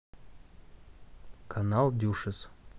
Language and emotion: Russian, neutral